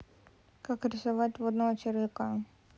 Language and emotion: Russian, neutral